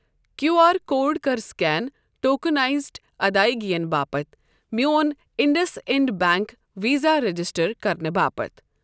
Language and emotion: Kashmiri, neutral